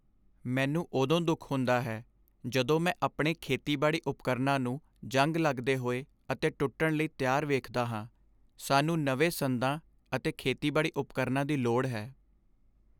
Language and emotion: Punjabi, sad